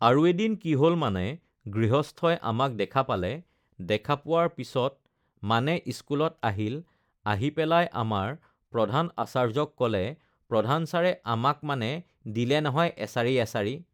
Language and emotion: Assamese, neutral